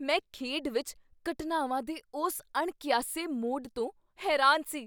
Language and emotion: Punjabi, surprised